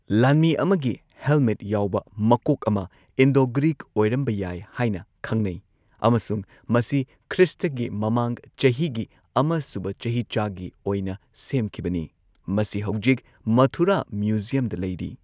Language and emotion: Manipuri, neutral